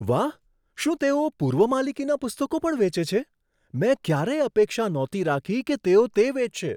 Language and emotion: Gujarati, surprised